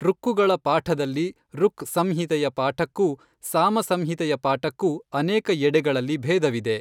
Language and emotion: Kannada, neutral